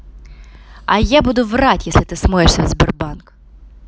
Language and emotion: Russian, angry